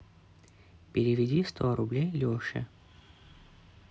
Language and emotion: Russian, neutral